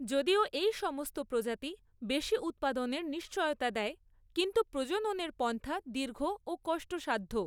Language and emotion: Bengali, neutral